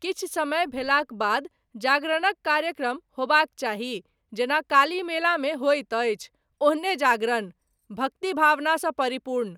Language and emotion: Maithili, neutral